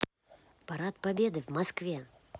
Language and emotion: Russian, positive